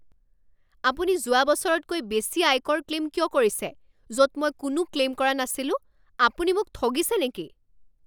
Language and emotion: Assamese, angry